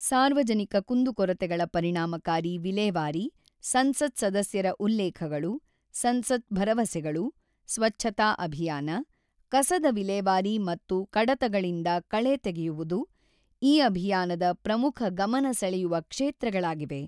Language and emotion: Kannada, neutral